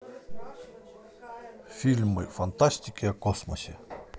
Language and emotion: Russian, positive